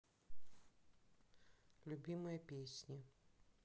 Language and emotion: Russian, neutral